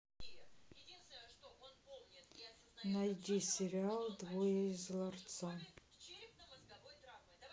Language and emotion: Russian, sad